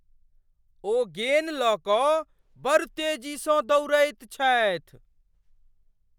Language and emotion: Maithili, surprised